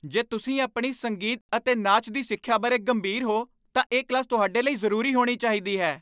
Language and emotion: Punjabi, angry